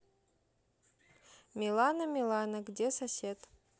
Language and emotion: Russian, neutral